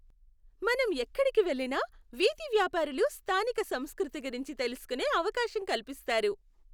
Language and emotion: Telugu, happy